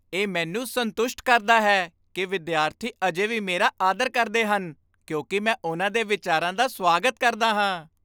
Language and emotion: Punjabi, happy